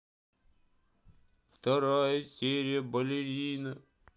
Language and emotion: Russian, sad